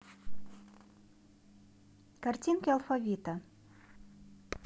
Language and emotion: Russian, neutral